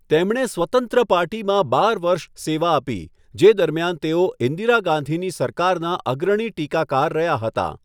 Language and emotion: Gujarati, neutral